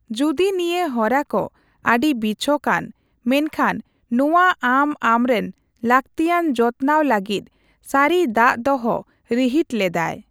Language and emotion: Santali, neutral